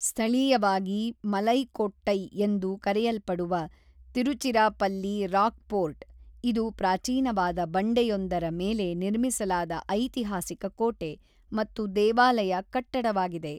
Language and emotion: Kannada, neutral